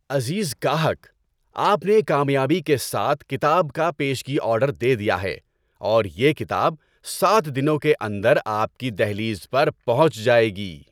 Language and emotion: Urdu, happy